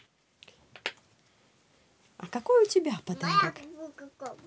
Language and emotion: Russian, positive